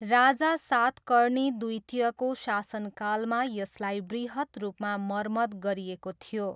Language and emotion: Nepali, neutral